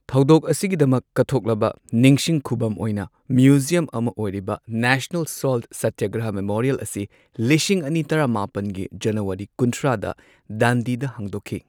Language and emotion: Manipuri, neutral